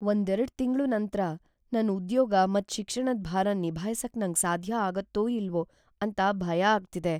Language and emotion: Kannada, fearful